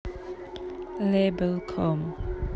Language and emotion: Russian, neutral